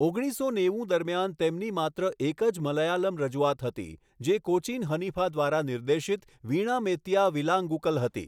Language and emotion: Gujarati, neutral